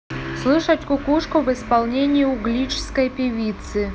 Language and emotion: Russian, neutral